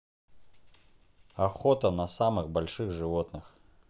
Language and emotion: Russian, neutral